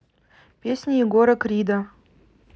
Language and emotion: Russian, neutral